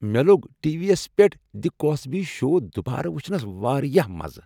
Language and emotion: Kashmiri, happy